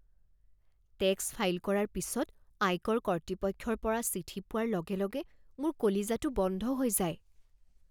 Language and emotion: Assamese, fearful